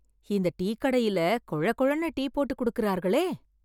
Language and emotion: Tamil, surprised